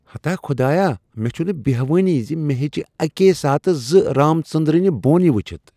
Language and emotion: Kashmiri, surprised